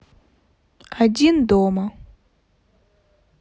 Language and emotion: Russian, neutral